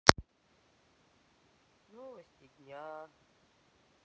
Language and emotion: Russian, sad